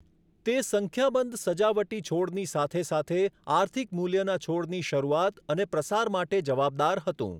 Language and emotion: Gujarati, neutral